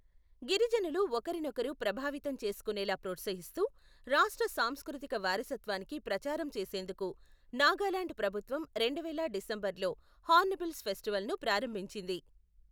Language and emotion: Telugu, neutral